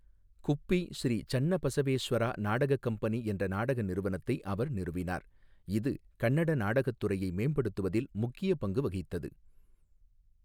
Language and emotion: Tamil, neutral